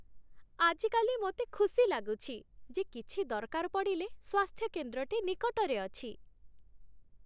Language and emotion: Odia, happy